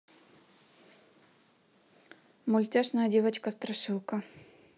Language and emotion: Russian, neutral